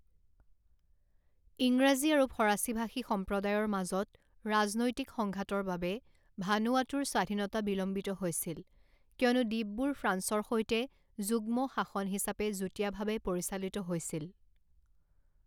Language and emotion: Assamese, neutral